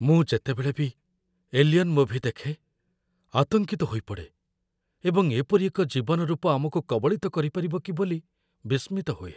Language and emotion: Odia, fearful